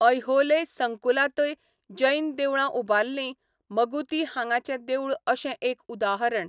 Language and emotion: Goan Konkani, neutral